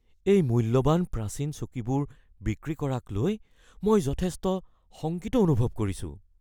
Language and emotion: Assamese, fearful